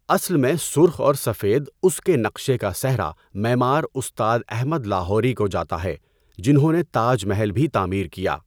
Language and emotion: Urdu, neutral